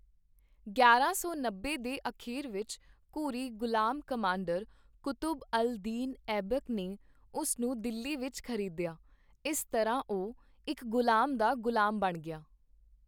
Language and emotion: Punjabi, neutral